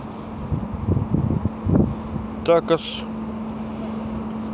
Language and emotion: Russian, neutral